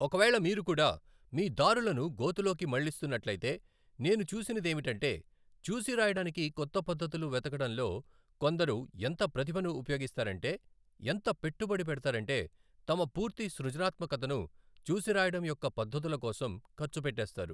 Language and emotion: Telugu, neutral